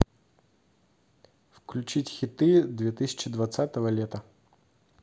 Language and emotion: Russian, neutral